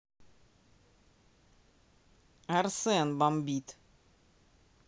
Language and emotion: Russian, neutral